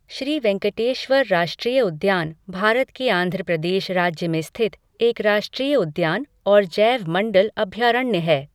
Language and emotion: Hindi, neutral